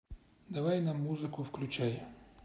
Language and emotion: Russian, neutral